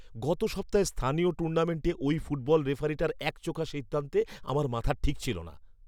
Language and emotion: Bengali, angry